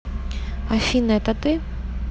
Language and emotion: Russian, neutral